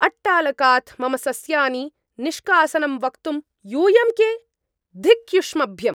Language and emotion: Sanskrit, angry